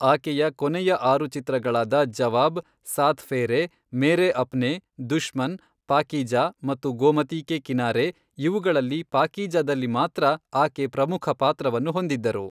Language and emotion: Kannada, neutral